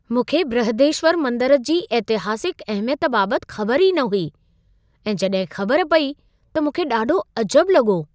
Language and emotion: Sindhi, surprised